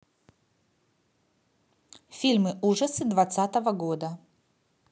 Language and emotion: Russian, neutral